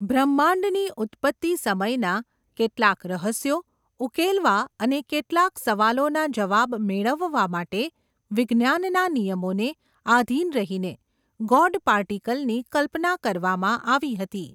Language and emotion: Gujarati, neutral